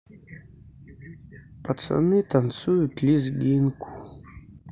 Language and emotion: Russian, sad